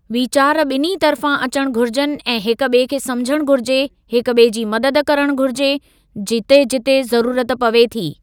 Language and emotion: Sindhi, neutral